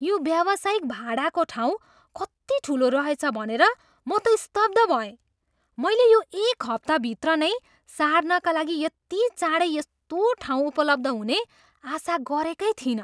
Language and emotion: Nepali, surprised